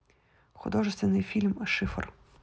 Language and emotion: Russian, neutral